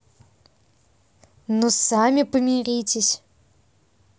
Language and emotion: Russian, neutral